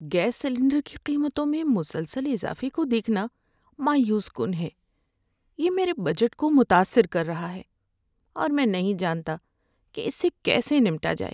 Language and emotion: Urdu, sad